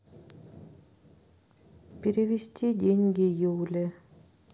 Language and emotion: Russian, neutral